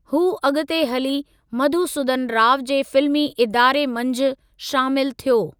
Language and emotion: Sindhi, neutral